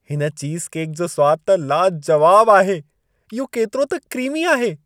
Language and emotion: Sindhi, happy